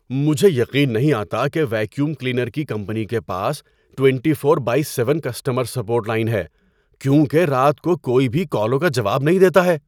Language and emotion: Urdu, surprised